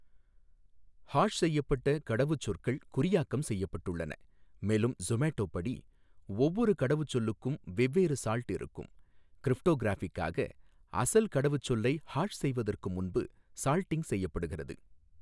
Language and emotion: Tamil, neutral